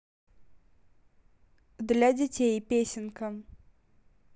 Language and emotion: Russian, neutral